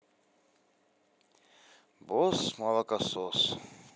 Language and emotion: Russian, sad